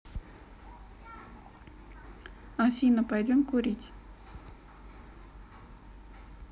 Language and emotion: Russian, neutral